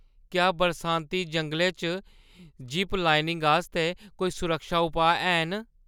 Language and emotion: Dogri, fearful